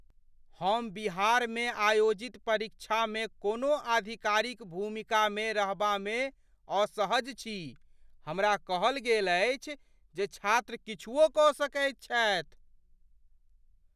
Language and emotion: Maithili, fearful